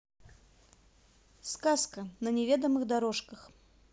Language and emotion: Russian, neutral